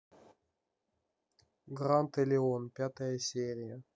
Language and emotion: Russian, neutral